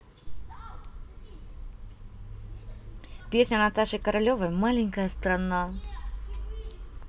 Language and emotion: Russian, neutral